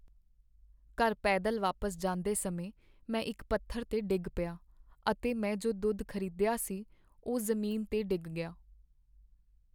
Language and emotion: Punjabi, sad